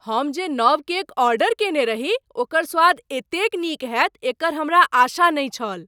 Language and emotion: Maithili, surprised